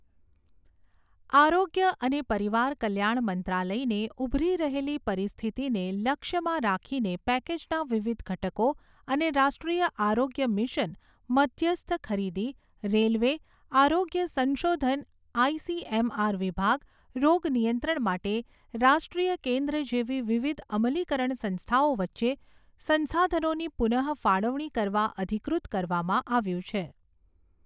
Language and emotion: Gujarati, neutral